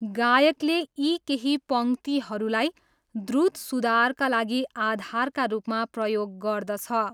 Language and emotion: Nepali, neutral